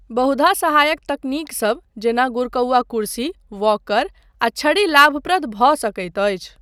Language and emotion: Maithili, neutral